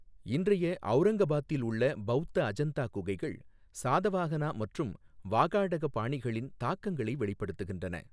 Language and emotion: Tamil, neutral